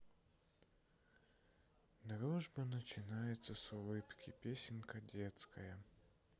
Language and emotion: Russian, sad